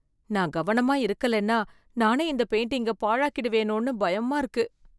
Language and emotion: Tamil, fearful